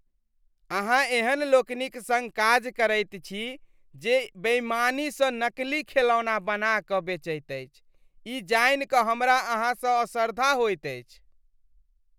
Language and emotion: Maithili, disgusted